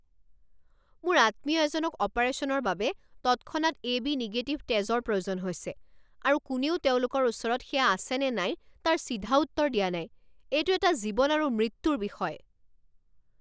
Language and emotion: Assamese, angry